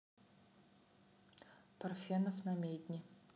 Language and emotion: Russian, neutral